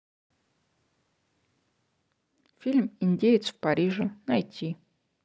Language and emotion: Russian, neutral